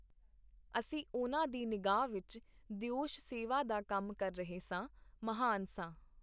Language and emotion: Punjabi, neutral